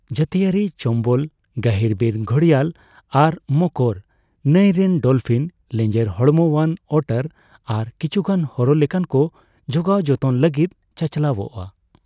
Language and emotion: Santali, neutral